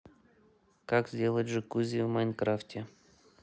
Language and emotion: Russian, neutral